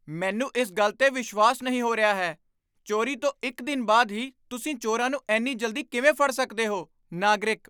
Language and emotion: Punjabi, surprised